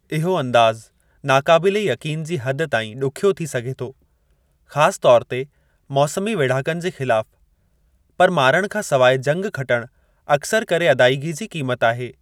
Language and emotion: Sindhi, neutral